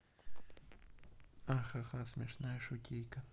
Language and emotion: Russian, neutral